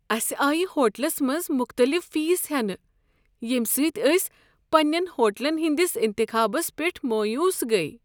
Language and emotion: Kashmiri, sad